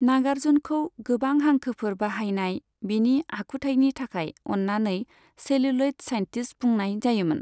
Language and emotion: Bodo, neutral